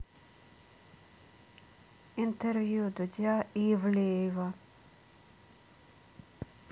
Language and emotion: Russian, neutral